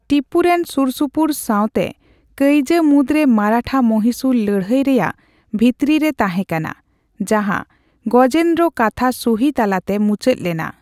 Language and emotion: Santali, neutral